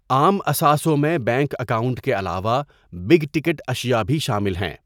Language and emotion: Urdu, neutral